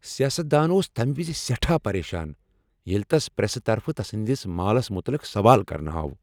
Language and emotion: Kashmiri, angry